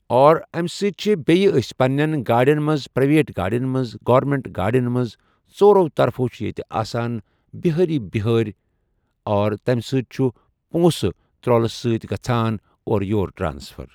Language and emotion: Kashmiri, neutral